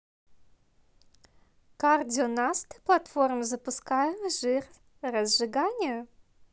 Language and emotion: Russian, positive